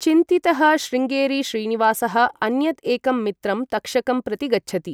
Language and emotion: Sanskrit, neutral